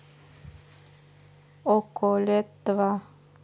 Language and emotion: Russian, neutral